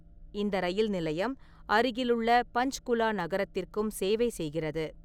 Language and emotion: Tamil, neutral